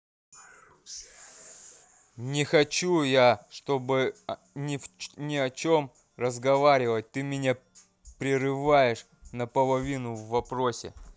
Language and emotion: Russian, angry